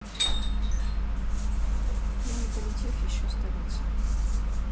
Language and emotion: Russian, neutral